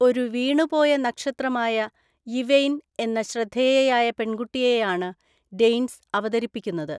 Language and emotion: Malayalam, neutral